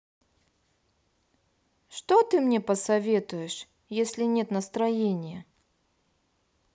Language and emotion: Russian, sad